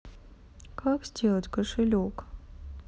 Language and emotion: Russian, sad